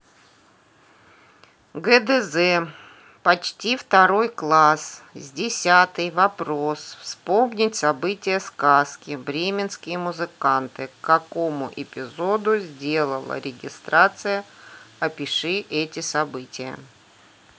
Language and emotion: Russian, neutral